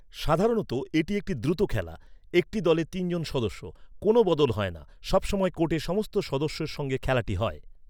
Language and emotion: Bengali, neutral